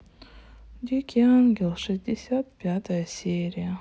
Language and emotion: Russian, sad